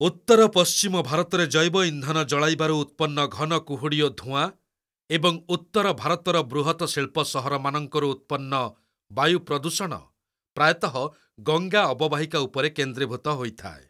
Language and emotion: Odia, neutral